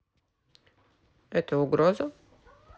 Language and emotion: Russian, neutral